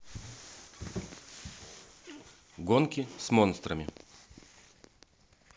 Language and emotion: Russian, neutral